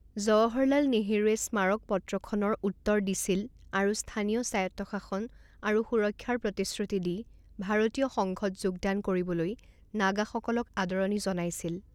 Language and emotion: Assamese, neutral